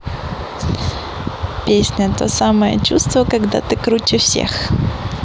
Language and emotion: Russian, positive